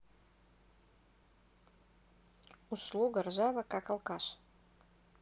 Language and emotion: Russian, neutral